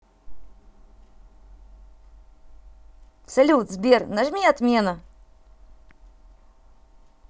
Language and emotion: Russian, positive